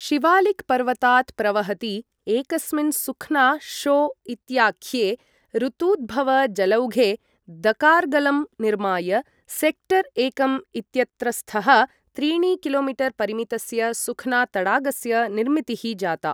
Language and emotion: Sanskrit, neutral